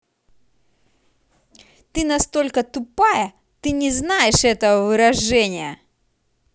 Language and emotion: Russian, angry